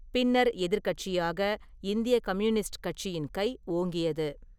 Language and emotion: Tamil, neutral